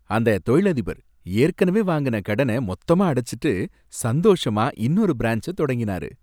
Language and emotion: Tamil, happy